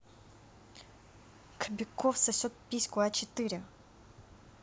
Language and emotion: Russian, angry